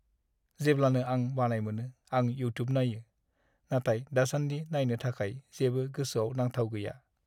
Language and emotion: Bodo, sad